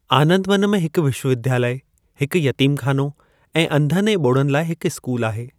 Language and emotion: Sindhi, neutral